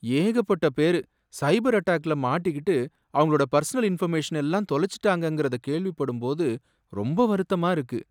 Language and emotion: Tamil, sad